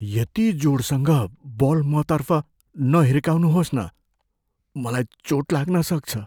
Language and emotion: Nepali, fearful